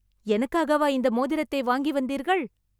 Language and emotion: Tamil, surprised